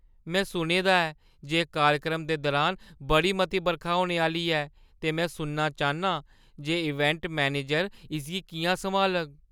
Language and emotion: Dogri, fearful